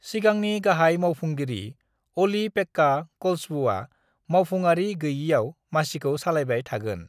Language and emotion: Bodo, neutral